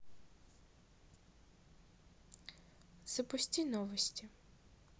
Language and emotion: Russian, neutral